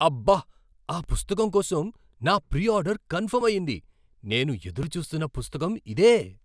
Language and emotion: Telugu, surprised